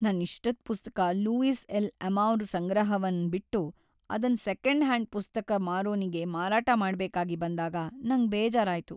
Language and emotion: Kannada, sad